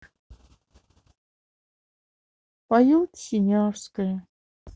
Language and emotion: Russian, sad